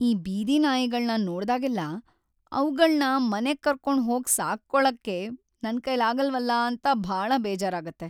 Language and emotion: Kannada, sad